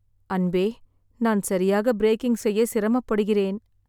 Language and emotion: Tamil, sad